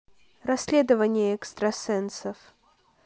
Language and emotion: Russian, neutral